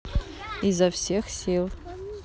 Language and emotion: Russian, neutral